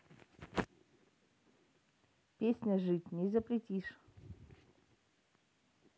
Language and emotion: Russian, neutral